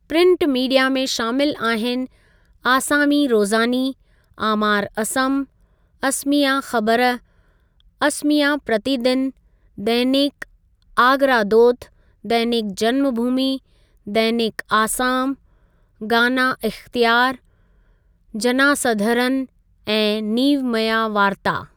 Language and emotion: Sindhi, neutral